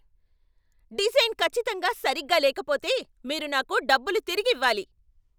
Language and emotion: Telugu, angry